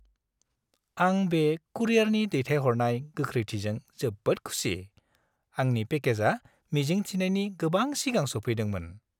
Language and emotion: Bodo, happy